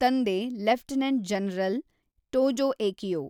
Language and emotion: Kannada, neutral